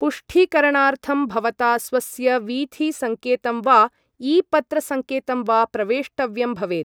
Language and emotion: Sanskrit, neutral